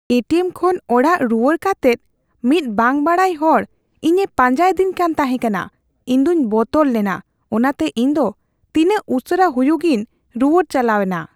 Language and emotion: Santali, fearful